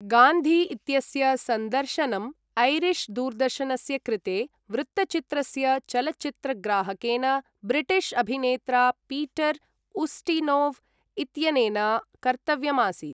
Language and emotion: Sanskrit, neutral